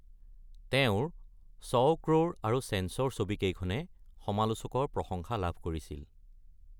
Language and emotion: Assamese, neutral